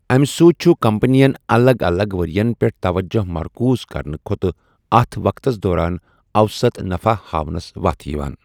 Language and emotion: Kashmiri, neutral